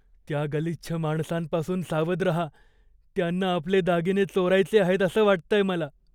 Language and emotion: Marathi, fearful